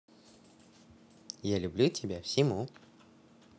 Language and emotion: Russian, positive